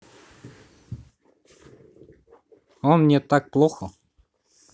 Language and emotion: Russian, neutral